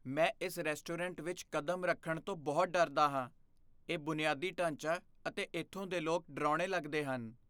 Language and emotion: Punjabi, fearful